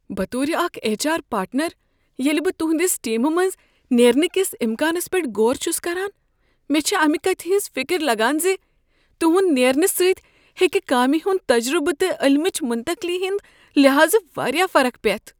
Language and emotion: Kashmiri, fearful